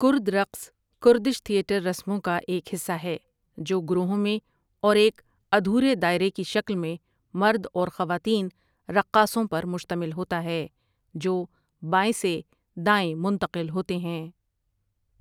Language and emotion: Urdu, neutral